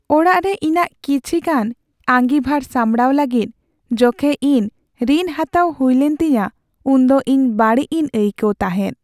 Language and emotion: Santali, sad